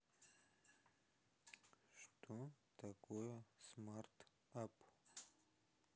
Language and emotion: Russian, neutral